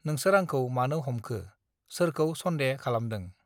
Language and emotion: Bodo, neutral